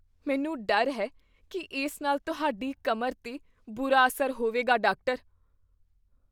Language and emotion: Punjabi, fearful